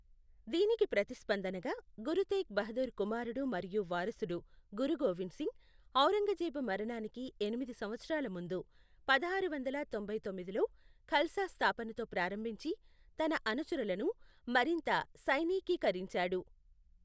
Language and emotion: Telugu, neutral